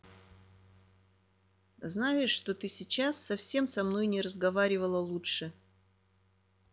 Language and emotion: Russian, neutral